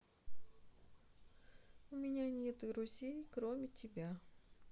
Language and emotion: Russian, sad